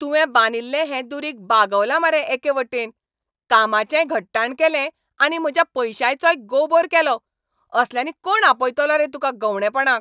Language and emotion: Goan Konkani, angry